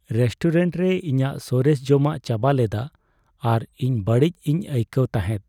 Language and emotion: Santali, sad